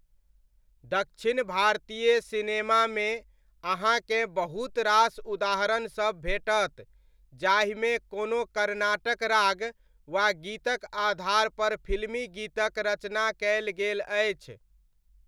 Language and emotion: Maithili, neutral